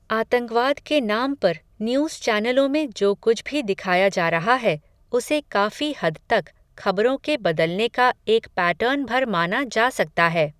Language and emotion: Hindi, neutral